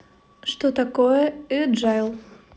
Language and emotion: Russian, neutral